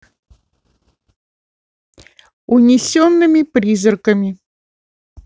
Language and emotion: Russian, neutral